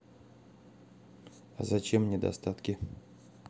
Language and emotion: Russian, neutral